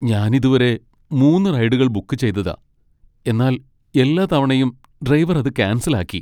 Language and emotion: Malayalam, sad